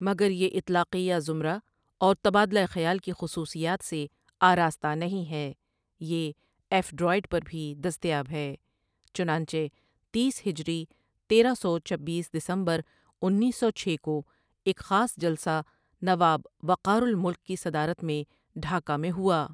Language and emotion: Urdu, neutral